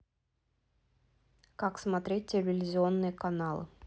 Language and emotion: Russian, neutral